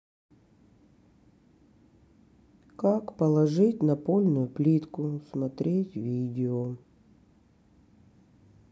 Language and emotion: Russian, sad